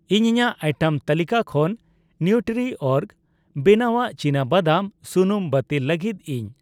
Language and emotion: Santali, neutral